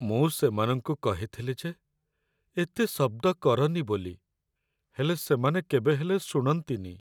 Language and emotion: Odia, sad